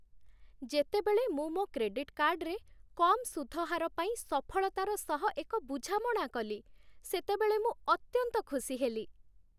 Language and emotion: Odia, happy